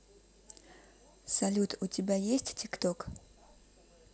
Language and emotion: Russian, neutral